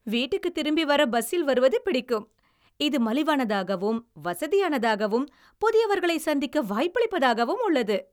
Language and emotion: Tamil, happy